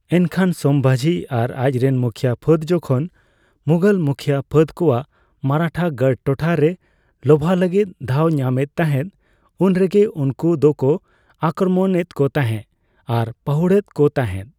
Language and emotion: Santali, neutral